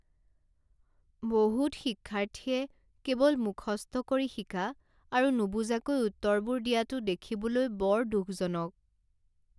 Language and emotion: Assamese, sad